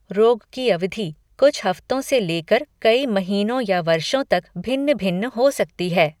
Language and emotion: Hindi, neutral